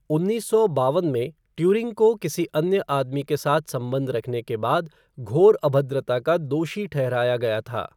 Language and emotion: Hindi, neutral